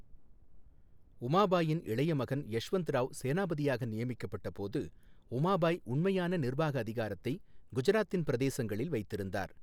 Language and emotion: Tamil, neutral